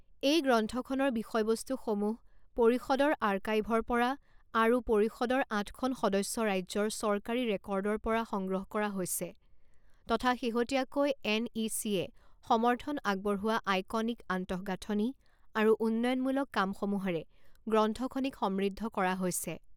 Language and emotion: Assamese, neutral